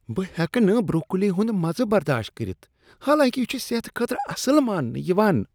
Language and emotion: Kashmiri, disgusted